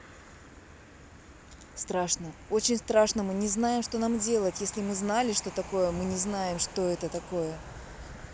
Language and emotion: Russian, neutral